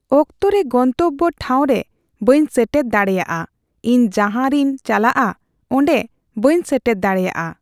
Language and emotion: Santali, neutral